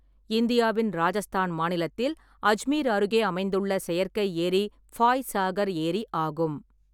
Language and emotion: Tamil, neutral